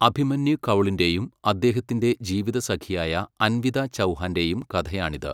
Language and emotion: Malayalam, neutral